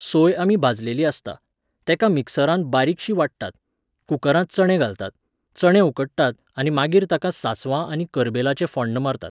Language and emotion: Goan Konkani, neutral